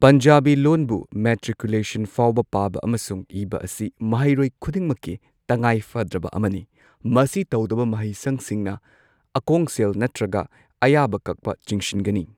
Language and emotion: Manipuri, neutral